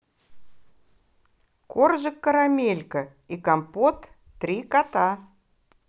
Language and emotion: Russian, positive